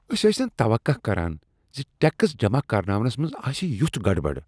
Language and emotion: Kashmiri, disgusted